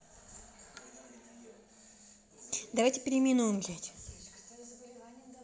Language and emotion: Russian, angry